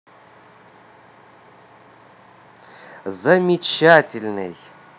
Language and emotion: Russian, positive